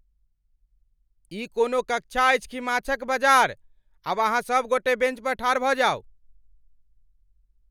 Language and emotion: Maithili, angry